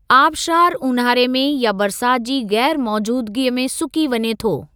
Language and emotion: Sindhi, neutral